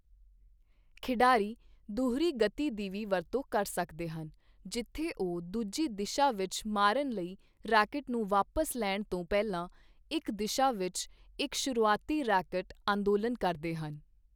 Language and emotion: Punjabi, neutral